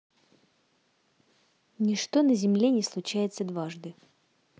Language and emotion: Russian, neutral